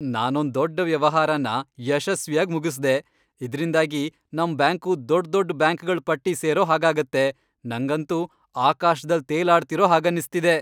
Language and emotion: Kannada, happy